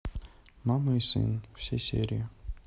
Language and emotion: Russian, neutral